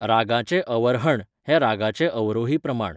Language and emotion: Goan Konkani, neutral